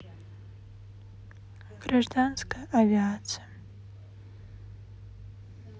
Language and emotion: Russian, sad